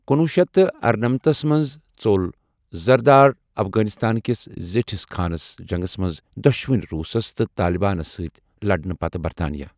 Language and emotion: Kashmiri, neutral